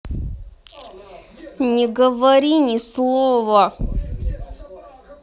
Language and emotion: Russian, angry